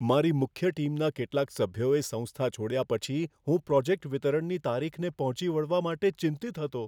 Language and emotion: Gujarati, fearful